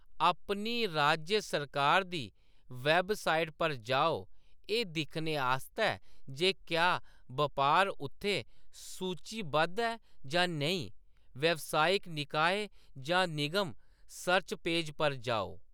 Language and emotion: Dogri, neutral